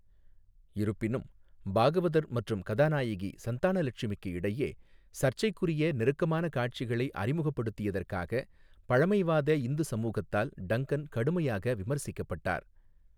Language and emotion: Tamil, neutral